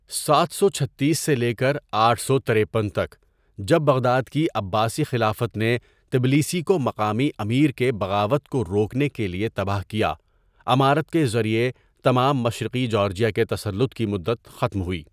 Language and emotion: Urdu, neutral